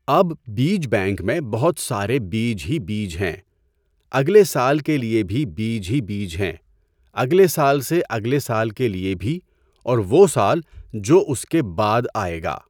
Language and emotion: Urdu, neutral